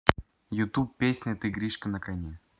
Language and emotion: Russian, neutral